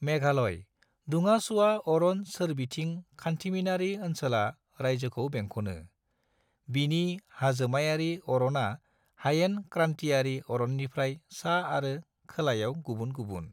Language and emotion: Bodo, neutral